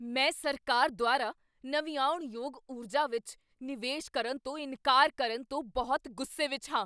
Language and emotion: Punjabi, angry